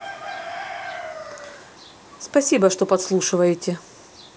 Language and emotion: Russian, neutral